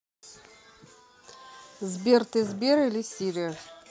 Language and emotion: Russian, neutral